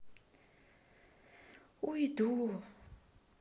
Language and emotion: Russian, sad